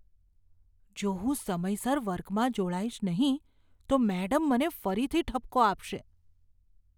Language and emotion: Gujarati, fearful